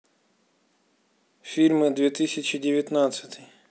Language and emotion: Russian, neutral